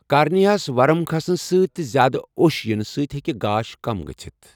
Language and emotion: Kashmiri, neutral